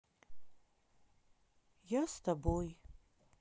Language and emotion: Russian, sad